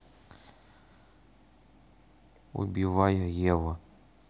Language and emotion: Russian, neutral